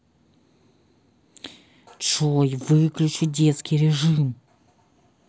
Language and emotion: Russian, angry